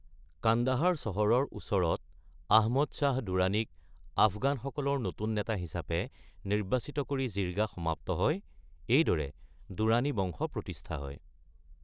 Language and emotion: Assamese, neutral